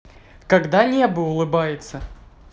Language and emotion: Russian, positive